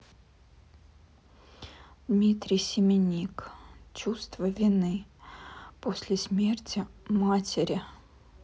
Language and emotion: Russian, sad